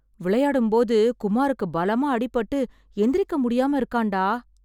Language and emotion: Tamil, sad